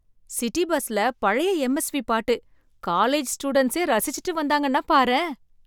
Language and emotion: Tamil, surprised